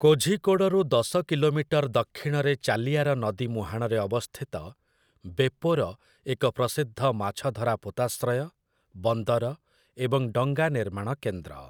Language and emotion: Odia, neutral